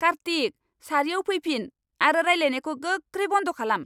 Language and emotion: Bodo, angry